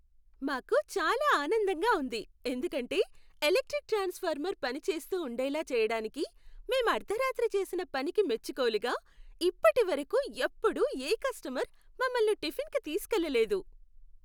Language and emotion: Telugu, happy